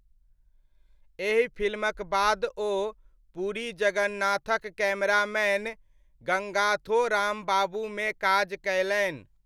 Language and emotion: Maithili, neutral